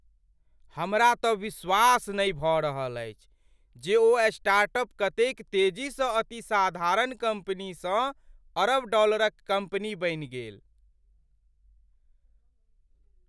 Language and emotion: Maithili, surprised